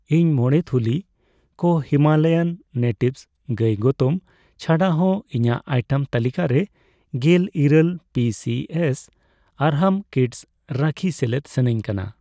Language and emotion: Santali, neutral